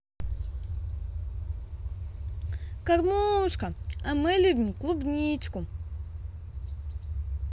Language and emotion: Russian, positive